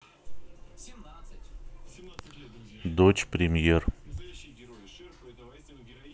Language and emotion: Russian, neutral